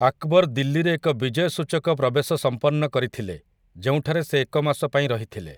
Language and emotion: Odia, neutral